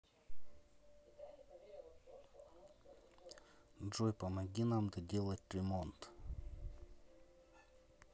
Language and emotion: Russian, neutral